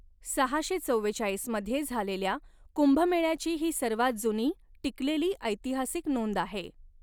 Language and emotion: Marathi, neutral